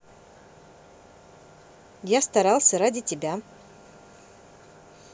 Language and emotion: Russian, neutral